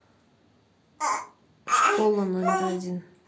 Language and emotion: Russian, neutral